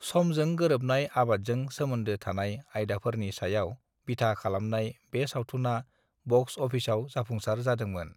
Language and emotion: Bodo, neutral